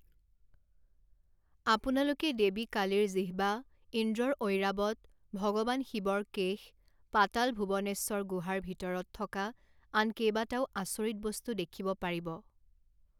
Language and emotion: Assamese, neutral